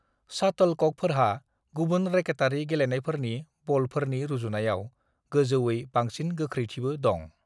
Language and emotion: Bodo, neutral